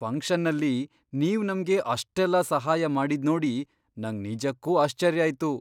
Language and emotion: Kannada, surprised